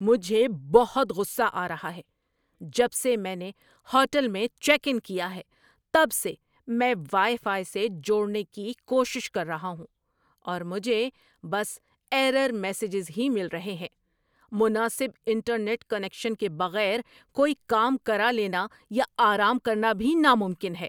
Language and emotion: Urdu, angry